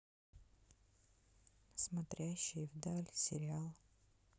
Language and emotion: Russian, sad